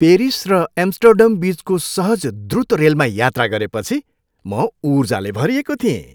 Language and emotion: Nepali, happy